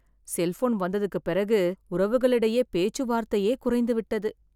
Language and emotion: Tamil, sad